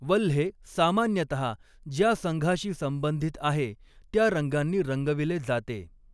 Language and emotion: Marathi, neutral